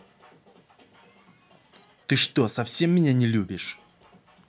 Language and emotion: Russian, angry